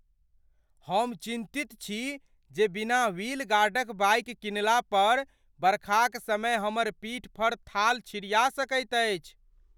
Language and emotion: Maithili, fearful